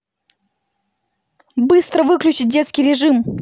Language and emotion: Russian, angry